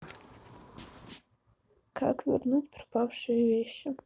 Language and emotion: Russian, sad